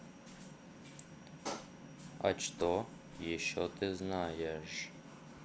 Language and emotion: Russian, neutral